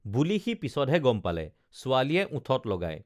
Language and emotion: Assamese, neutral